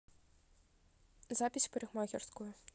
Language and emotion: Russian, neutral